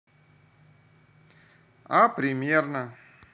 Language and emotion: Russian, neutral